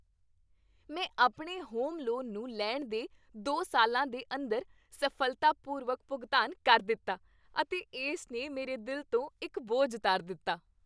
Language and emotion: Punjabi, happy